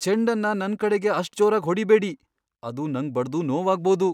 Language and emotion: Kannada, fearful